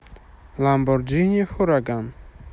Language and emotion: Russian, neutral